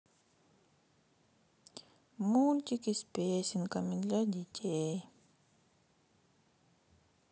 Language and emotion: Russian, sad